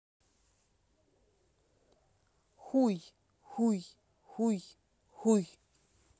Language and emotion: Russian, angry